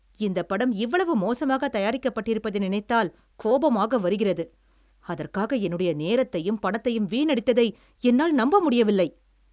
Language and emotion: Tamil, angry